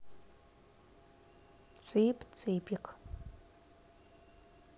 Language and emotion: Russian, neutral